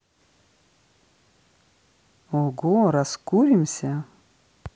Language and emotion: Russian, positive